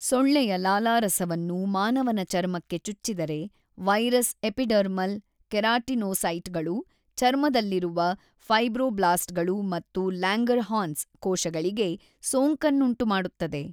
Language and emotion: Kannada, neutral